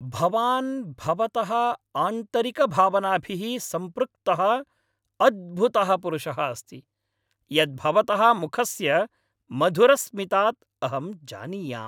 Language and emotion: Sanskrit, happy